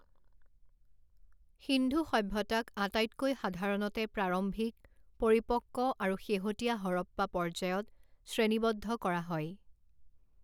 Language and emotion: Assamese, neutral